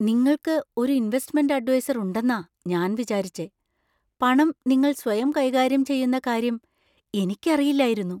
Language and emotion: Malayalam, surprised